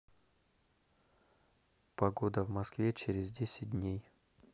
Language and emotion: Russian, neutral